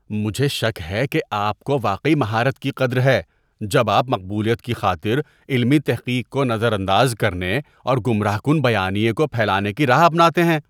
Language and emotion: Urdu, disgusted